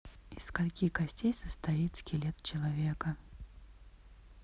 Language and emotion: Russian, neutral